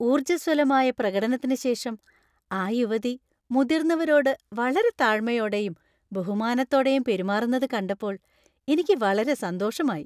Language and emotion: Malayalam, happy